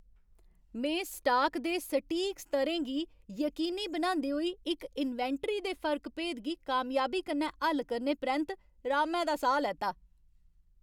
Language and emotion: Dogri, happy